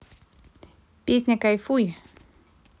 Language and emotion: Russian, positive